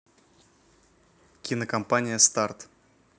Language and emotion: Russian, neutral